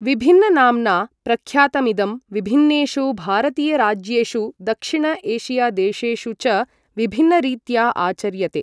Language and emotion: Sanskrit, neutral